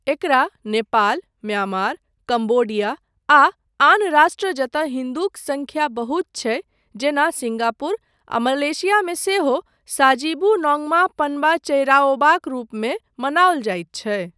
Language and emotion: Maithili, neutral